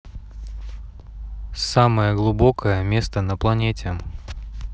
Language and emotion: Russian, neutral